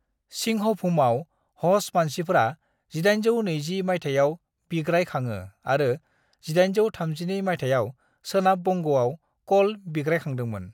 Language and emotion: Bodo, neutral